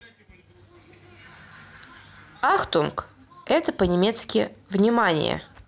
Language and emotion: Russian, neutral